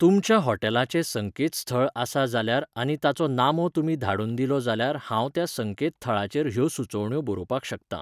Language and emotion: Goan Konkani, neutral